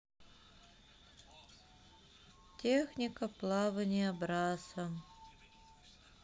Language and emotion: Russian, sad